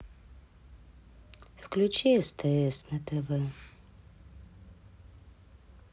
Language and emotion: Russian, sad